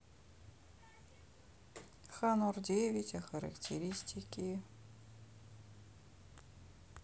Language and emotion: Russian, sad